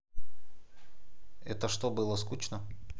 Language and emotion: Russian, neutral